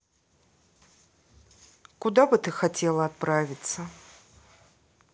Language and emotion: Russian, neutral